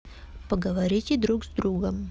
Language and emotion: Russian, neutral